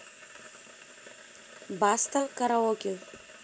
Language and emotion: Russian, neutral